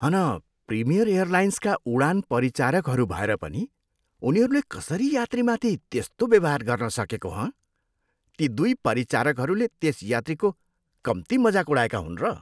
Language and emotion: Nepali, disgusted